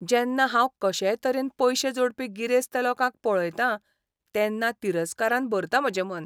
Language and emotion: Goan Konkani, disgusted